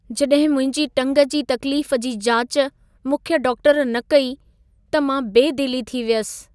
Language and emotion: Sindhi, sad